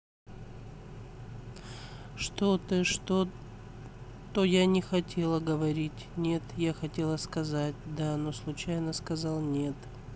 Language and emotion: Russian, neutral